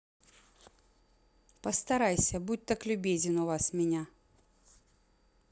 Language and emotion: Russian, neutral